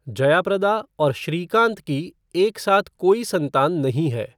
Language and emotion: Hindi, neutral